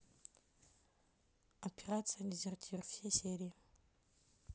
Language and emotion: Russian, neutral